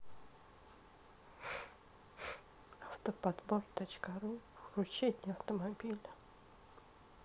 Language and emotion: Russian, sad